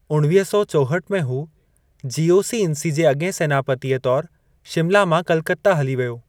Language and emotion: Sindhi, neutral